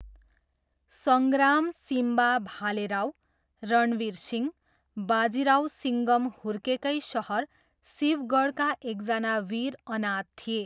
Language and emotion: Nepali, neutral